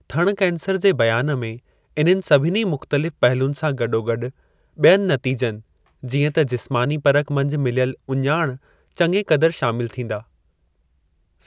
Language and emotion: Sindhi, neutral